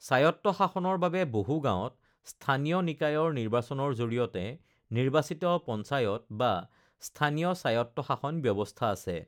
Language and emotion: Assamese, neutral